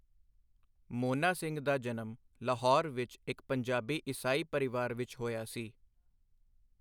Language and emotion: Punjabi, neutral